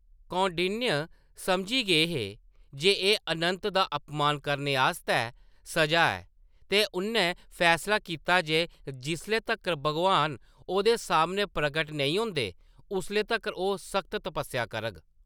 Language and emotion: Dogri, neutral